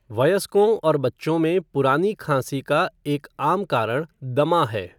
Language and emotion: Hindi, neutral